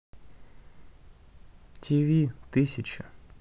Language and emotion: Russian, sad